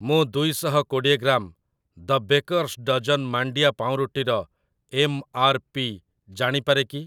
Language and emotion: Odia, neutral